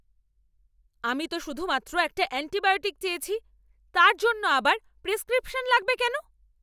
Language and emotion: Bengali, angry